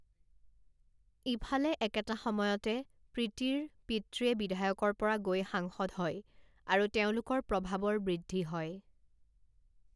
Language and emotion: Assamese, neutral